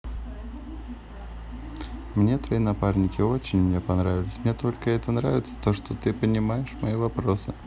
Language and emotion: Russian, neutral